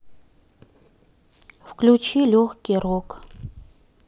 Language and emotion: Russian, neutral